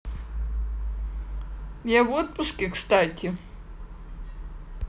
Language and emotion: Russian, neutral